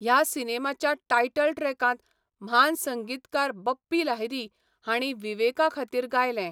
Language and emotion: Goan Konkani, neutral